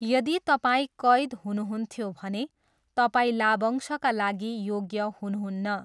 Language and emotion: Nepali, neutral